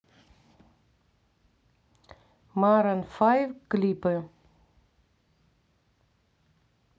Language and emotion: Russian, neutral